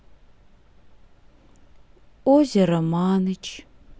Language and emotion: Russian, sad